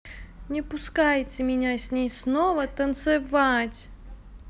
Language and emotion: Russian, angry